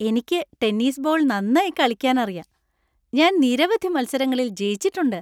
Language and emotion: Malayalam, happy